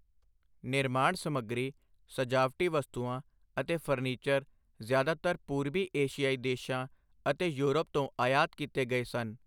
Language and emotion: Punjabi, neutral